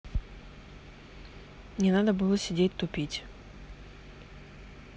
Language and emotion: Russian, neutral